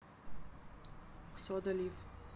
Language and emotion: Russian, neutral